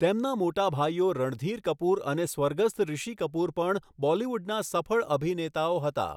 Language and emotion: Gujarati, neutral